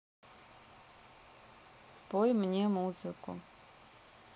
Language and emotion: Russian, neutral